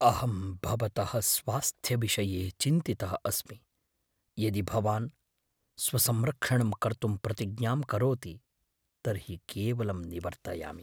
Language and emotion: Sanskrit, fearful